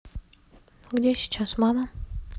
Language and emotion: Russian, neutral